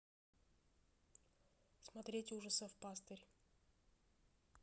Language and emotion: Russian, neutral